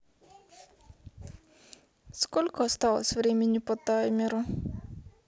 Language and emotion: Russian, sad